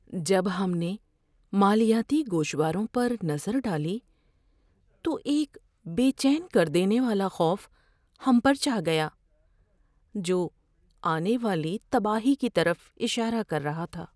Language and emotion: Urdu, fearful